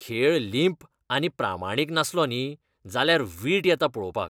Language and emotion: Goan Konkani, disgusted